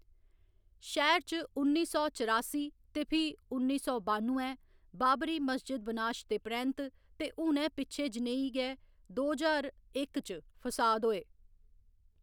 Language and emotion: Dogri, neutral